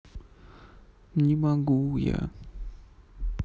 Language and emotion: Russian, sad